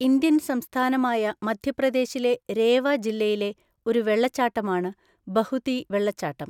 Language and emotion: Malayalam, neutral